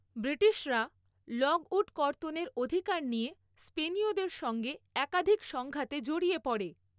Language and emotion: Bengali, neutral